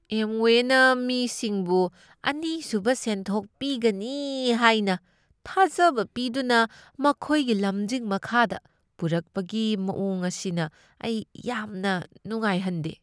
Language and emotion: Manipuri, disgusted